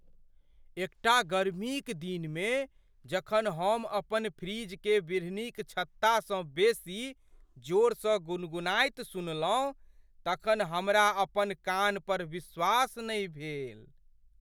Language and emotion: Maithili, surprised